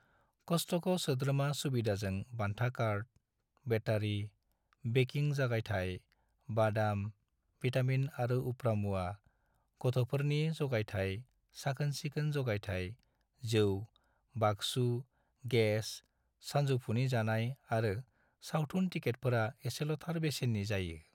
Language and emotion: Bodo, neutral